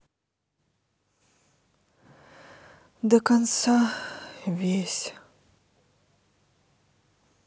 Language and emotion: Russian, sad